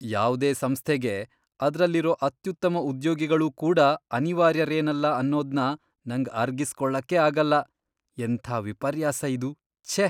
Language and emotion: Kannada, disgusted